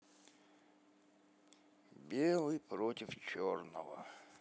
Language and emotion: Russian, sad